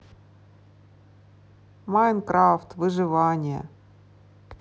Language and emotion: Russian, sad